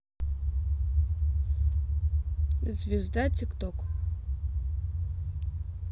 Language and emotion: Russian, neutral